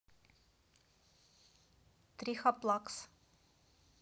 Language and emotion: Russian, neutral